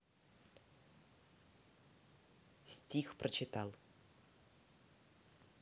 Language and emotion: Russian, neutral